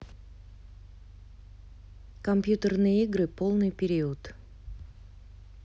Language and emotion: Russian, neutral